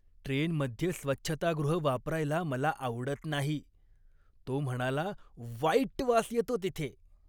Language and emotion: Marathi, disgusted